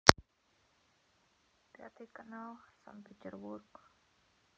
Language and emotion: Russian, sad